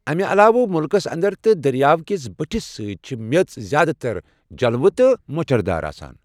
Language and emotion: Kashmiri, neutral